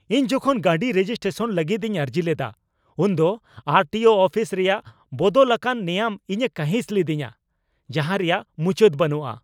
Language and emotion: Santali, angry